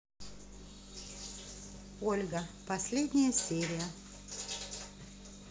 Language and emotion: Russian, neutral